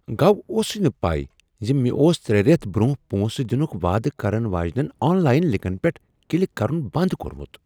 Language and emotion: Kashmiri, surprised